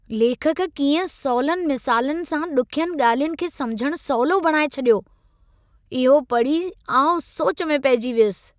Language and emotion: Sindhi, surprised